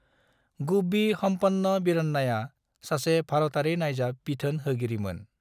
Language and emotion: Bodo, neutral